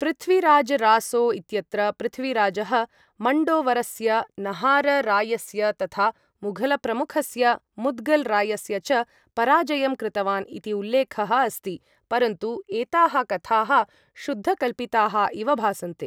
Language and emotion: Sanskrit, neutral